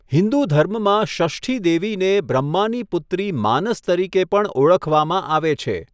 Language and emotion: Gujarati, neutral